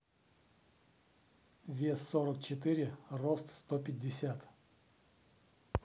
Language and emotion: Russian, neutral